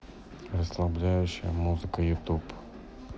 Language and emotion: Russian, neutral